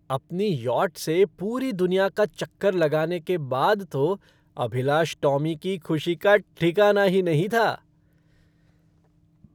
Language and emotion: Hindi, happy